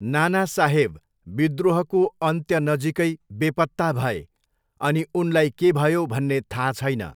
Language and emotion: Nepali, neutral